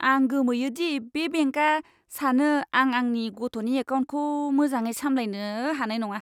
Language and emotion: Bodo, disgusted